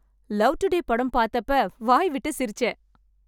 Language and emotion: Tamil, happy